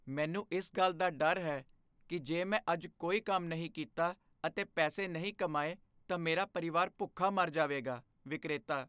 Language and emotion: Punjabi, fearful